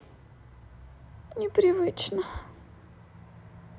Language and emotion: Russian, sad